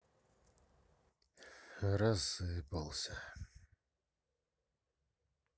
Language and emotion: Russian, sad